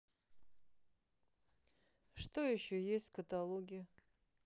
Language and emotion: Russian, neutral